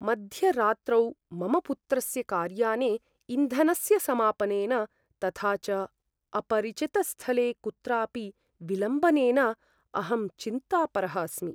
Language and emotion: Sanskrit, fearful